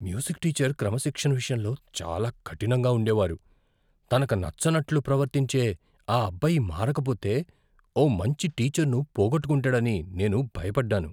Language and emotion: Telugu, fearful